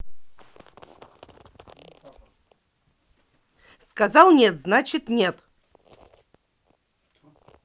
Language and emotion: Russian, angry